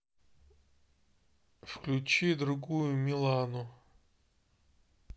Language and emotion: Russian, neutral